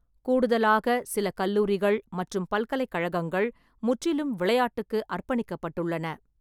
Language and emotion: Tamil, neutral